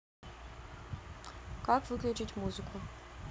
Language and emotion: Russian, neutral